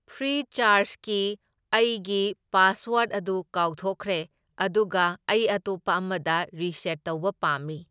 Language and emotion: Manipuri, neutral